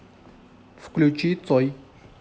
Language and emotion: Russian, neutral